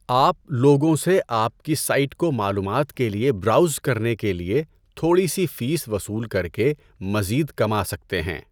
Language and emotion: Urdu, neutral